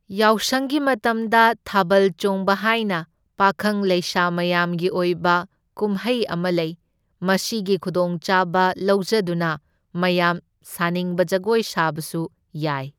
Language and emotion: Manipuri, neutral